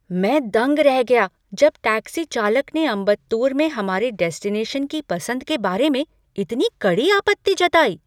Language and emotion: Hindi, surprised